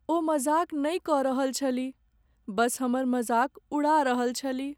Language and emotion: Maithili, sad